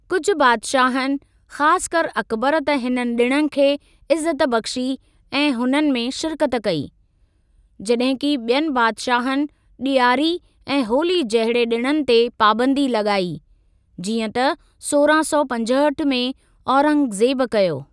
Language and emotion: Sindhi, neutral